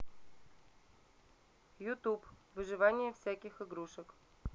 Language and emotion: Russian, neutral